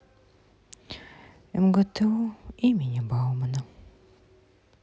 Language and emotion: Russian, sad